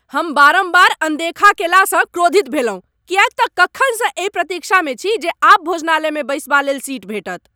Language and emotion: Maithili, angry